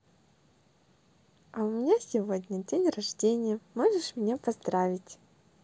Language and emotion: Russian, positive